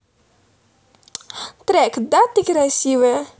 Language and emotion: Russian, positive